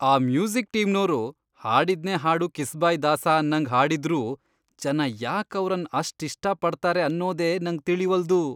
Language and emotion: Kannada, disgusted